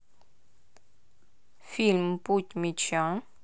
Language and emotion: Russian, neutral